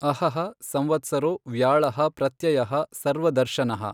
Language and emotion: Kannada, neutral